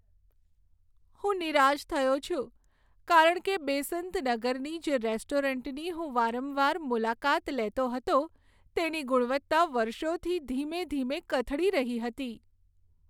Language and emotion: Gujarati, sad